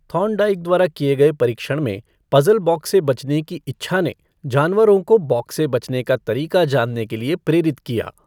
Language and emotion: Hindi, neutral